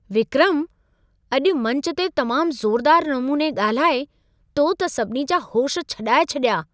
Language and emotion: Sindhi, surprised